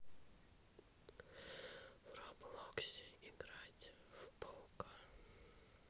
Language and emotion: Russian, neutral